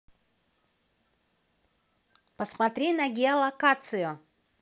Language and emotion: Russian, positive